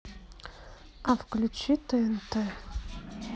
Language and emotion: Russian, sad